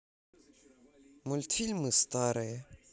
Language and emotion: Russian, neutral